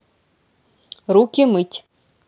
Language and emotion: Russian, neutral